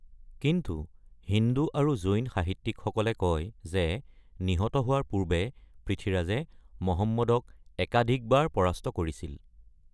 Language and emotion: Assamese, neutral